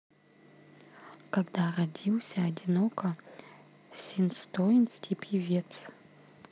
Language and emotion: Russian, neutral